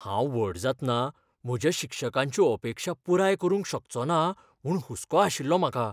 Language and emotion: Goan Konkani, fearful